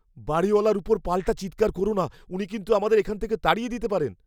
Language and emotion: Bengali, fearful